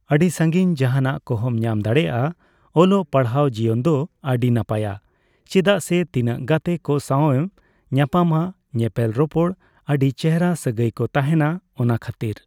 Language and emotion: Santali, neutral